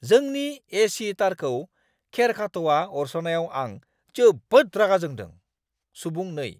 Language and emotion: Bodo, angry